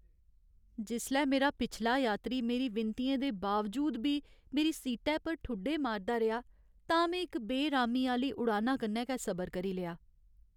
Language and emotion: Dogri, sad